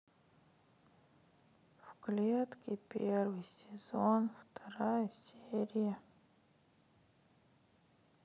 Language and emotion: Russian, sad